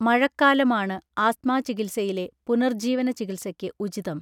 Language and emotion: Malayalam, neutral